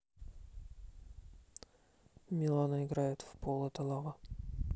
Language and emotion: Russian, neutral